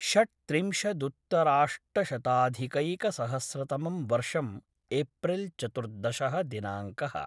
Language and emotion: Sanskrit, neutral